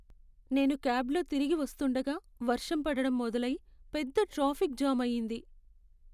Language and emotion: Telugu, sad